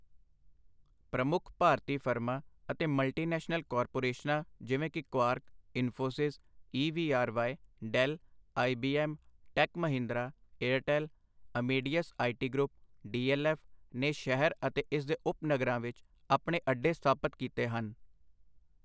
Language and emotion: Punjabi, neutral